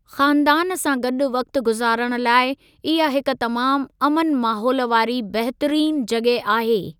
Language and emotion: Sindhi, neutral